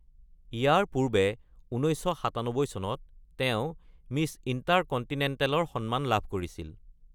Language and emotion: Assamese, neutral